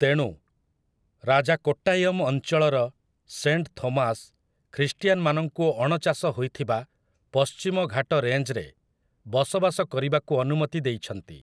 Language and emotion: Odia, neutral